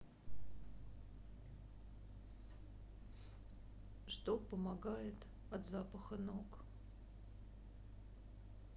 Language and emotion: Russian, sad